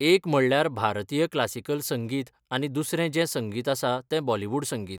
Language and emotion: Goan Konkani, neutral